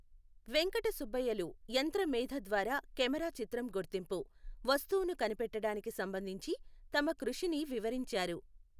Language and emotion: Telugu, neutral